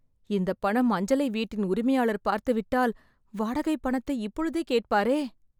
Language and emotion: Tamil, fearful